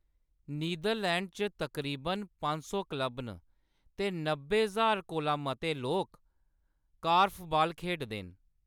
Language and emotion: Dogri, neutral